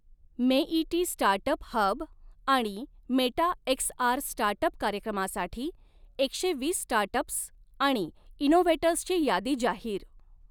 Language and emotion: Marathi, neutral